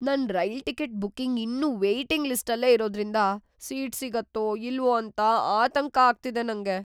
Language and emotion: Kannada, fearful